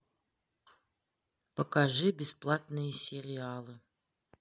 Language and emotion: Russian, neutral